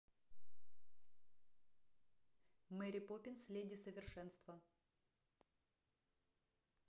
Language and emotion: Russian, neutral